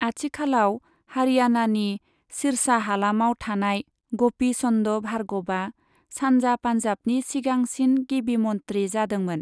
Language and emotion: Bodo, neutral